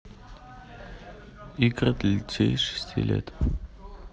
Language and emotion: Russian, neutral